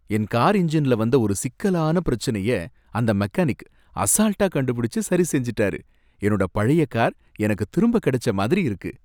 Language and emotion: Tamil, happy